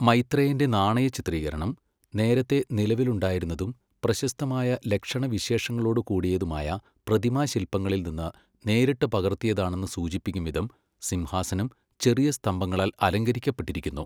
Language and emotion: Malayalam, neutral